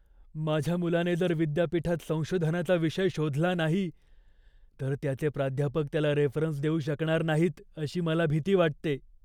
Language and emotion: Marathi, fearful